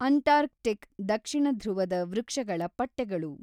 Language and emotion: Kannada, neutral